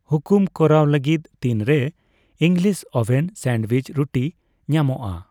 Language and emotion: Santali, neutral